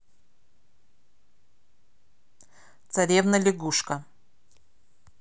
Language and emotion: Russian, neutral